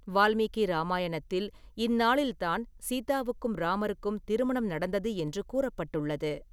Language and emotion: Tamil, neutral